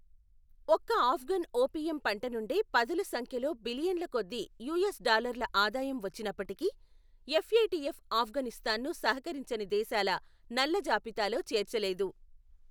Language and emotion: Telugu, neutral